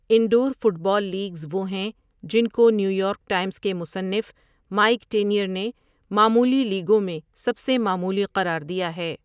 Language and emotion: Urdu, neutral